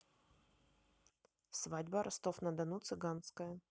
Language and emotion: Russian, neutral